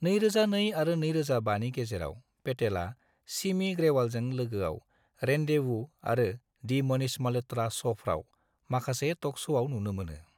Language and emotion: Bodo, neutral